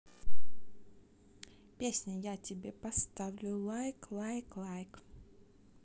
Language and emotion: Russian, neutral